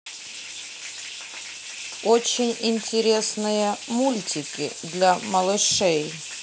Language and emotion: Russian, neutral